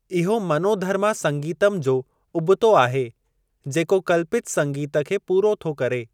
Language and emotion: Sindhi, neutral